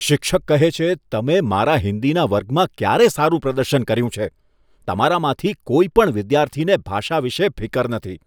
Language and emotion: Gujarati, disgusted